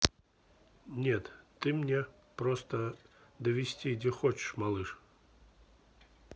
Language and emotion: Russian, neutral